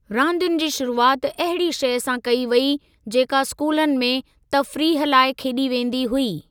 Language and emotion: Sindhi, neutral